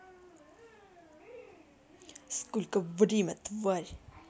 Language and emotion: Russian, angry